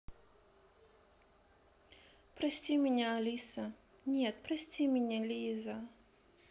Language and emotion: Russian, sad